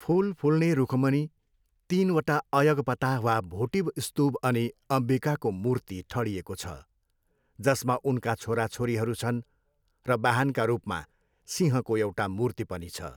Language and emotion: Nepali, neutral